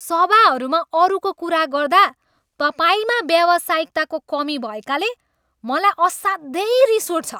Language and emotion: Nepali, angry